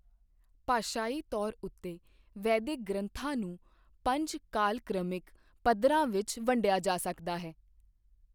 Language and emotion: Punjabi, neutral